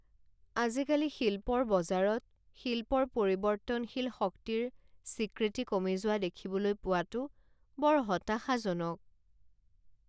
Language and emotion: Assamese, sad